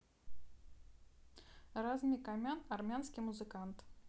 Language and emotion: Russian, neutral